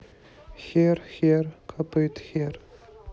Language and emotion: Russian, sad